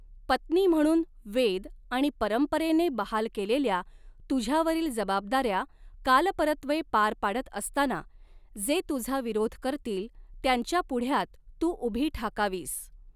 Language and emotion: Marathi, neutral